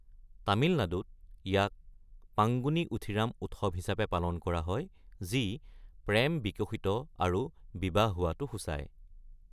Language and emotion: Assamese, neutral